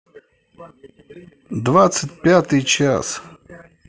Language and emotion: Russian, neutral